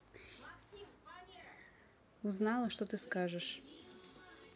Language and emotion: Russian, neutral